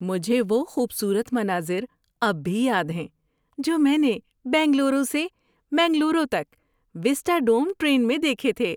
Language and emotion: Urdu, happy